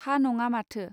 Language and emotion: Bodo, neutral